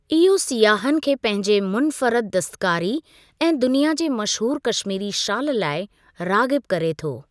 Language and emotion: Sindhi, neutral